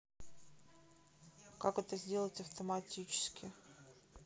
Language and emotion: Russian, neutral